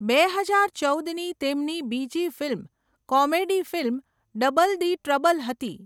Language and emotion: Gujarati, neutral